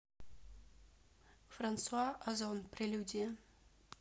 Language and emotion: Russian, neutral